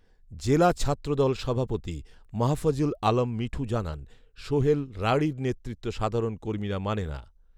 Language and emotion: Bengali, neutral